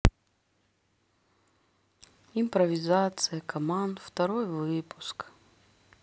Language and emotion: Russian, sad